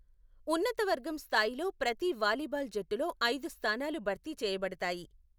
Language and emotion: Telugu, neutral